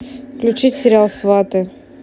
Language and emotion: Russian, neutral